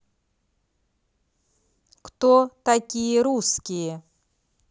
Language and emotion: Russian, neutral